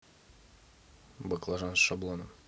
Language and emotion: Russian, neutral